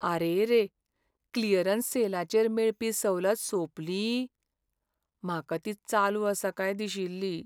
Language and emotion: Goan Konkani, sad